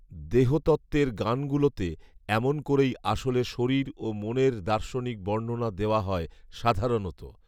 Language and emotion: Bengali, neutral